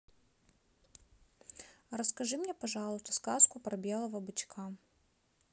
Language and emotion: Russian, neutral